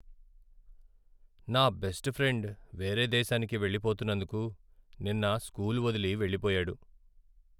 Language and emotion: Telugu, sad